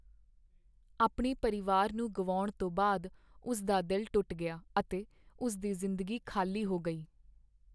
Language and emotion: Punjabi, sad